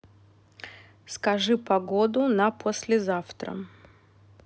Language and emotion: Russian, neutral